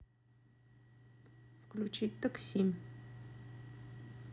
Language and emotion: Russian, neutral